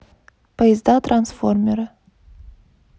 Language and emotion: Russian, neutral